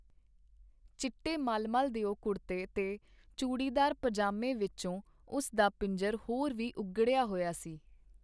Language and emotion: Punjabi, neutral